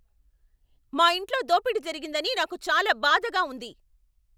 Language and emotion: Telugu, angry